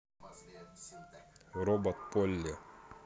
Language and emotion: Russian, neutral